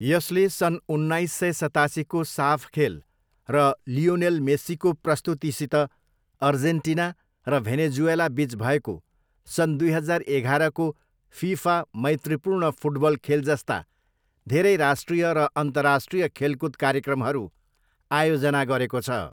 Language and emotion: Nepali, neutral